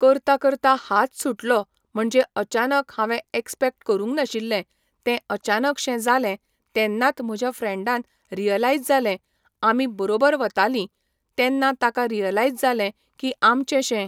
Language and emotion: Goan Konkani, neutral